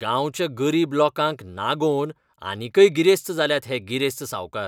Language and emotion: Goan Konkani, disgusted